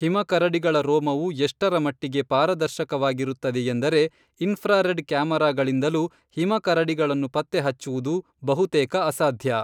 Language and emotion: Kannada, neutral